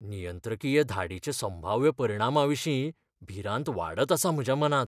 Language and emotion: Goan Konkani, fearful